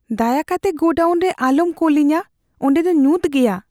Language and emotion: Santali, fearful